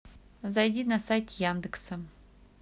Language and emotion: Russian, neutral